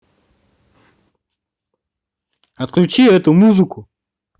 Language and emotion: Russian, angry